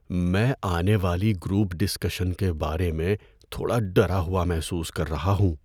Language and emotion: Urdu, fearful